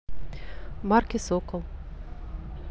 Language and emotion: Russian, neutral